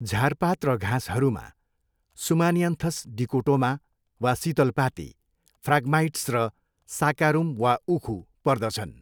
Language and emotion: Nepali, neutral